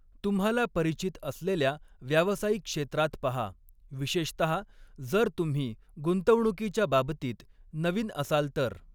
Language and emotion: Marathi, neutral